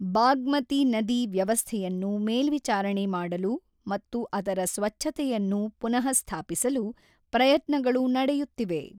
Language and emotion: Kannada, neutral